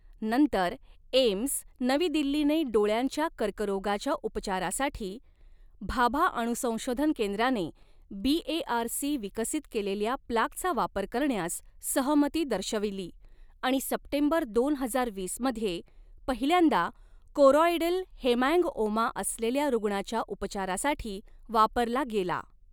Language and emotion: Marathi, neutral